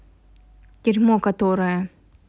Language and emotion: Russian, angry